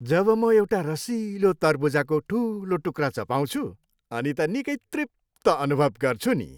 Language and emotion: Nepali, happy